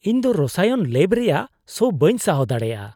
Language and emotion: Santali, disgusted